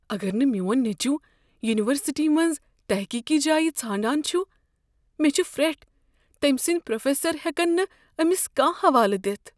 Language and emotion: Kashmiri, fearful